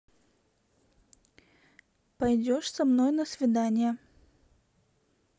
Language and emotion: Russian, neutral